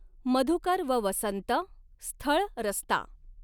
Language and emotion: Marathi, neutral